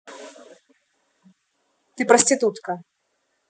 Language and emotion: Russian, angry